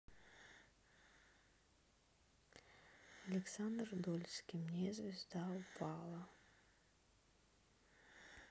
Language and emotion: Russian, neutral